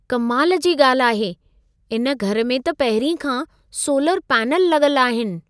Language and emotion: Sindhi, surprised